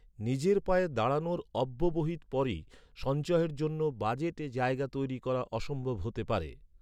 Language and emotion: Bengali, neutral